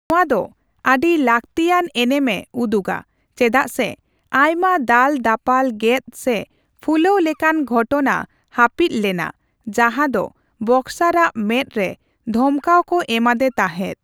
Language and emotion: Santali, neutral